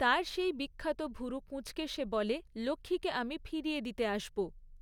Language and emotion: Bengali, neutral